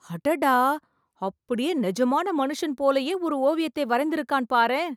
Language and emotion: Tamil, surprised